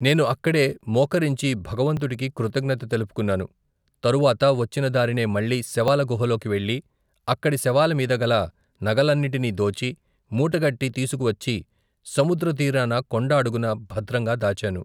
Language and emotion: Telugu, neutral